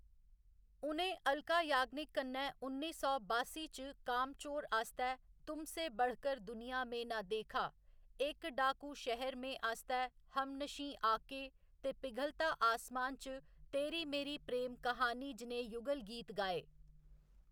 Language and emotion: Dogri, neutral